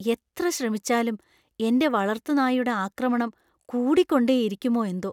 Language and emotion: Malayalam, fearful